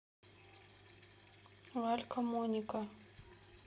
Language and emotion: Russian, neutral